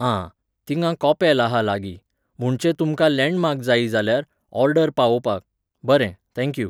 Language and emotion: Goan Konkani, neutral